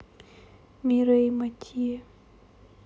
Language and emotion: Russian, sad